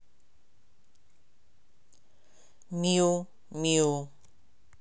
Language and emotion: Russian, neutral